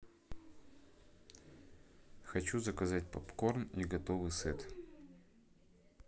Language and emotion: Russian, neutral